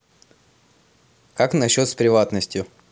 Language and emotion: Russian, positive